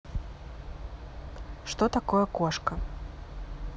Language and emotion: Russian, neutral